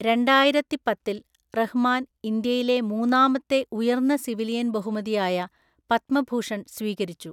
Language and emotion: Malayalam, neutral